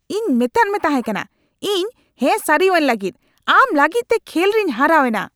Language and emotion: Santali, angry